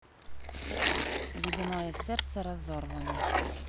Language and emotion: Russian, neutral